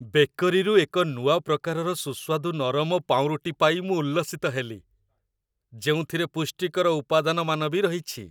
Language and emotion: Odia, happy